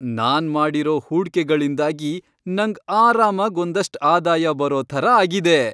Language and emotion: Kannada, happy